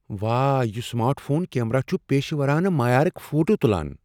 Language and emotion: Kashmiri, surprised